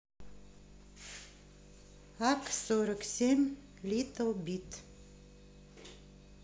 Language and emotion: Russian, neutral